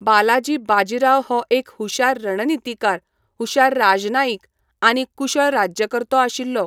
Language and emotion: Goan Konkani, neutral